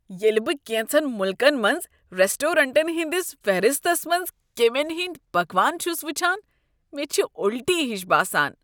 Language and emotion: Kashmiri, disgusted